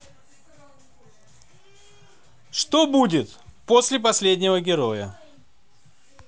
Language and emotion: Russian, neutral